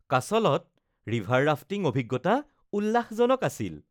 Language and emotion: Assamese, happy